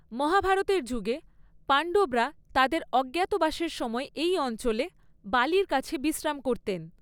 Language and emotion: Bengali, neutral